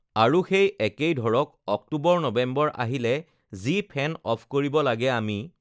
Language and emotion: Assamese, neutral